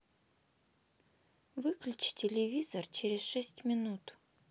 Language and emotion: Russian, neutral